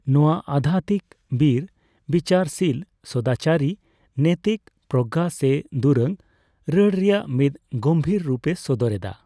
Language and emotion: Santali, neutral